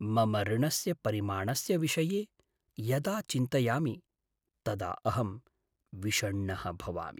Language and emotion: Sanskrit, sad